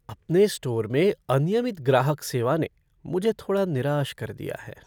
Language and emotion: Hindi, sad